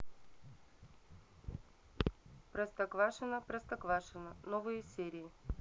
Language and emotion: Russian, neutral